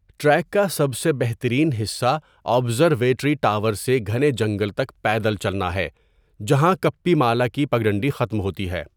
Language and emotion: Urdu, neutral